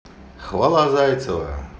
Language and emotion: Russian, positive